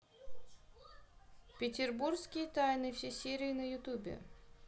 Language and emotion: Russian, neutral